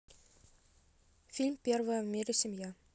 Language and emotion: Russian, neutral